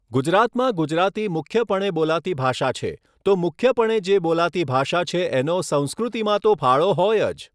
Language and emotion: Gujarati, neutral